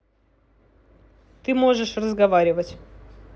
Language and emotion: Russian, neutral